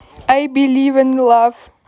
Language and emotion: Russian, neutral